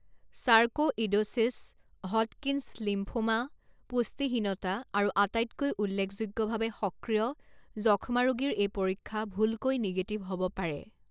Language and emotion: Assamese, neutral